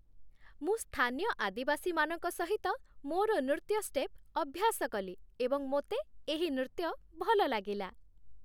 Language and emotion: Odia, happy